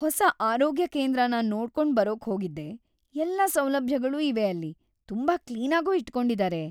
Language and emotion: Kannada, happy